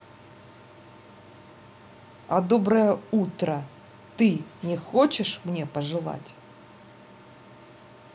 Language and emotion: Russian, angry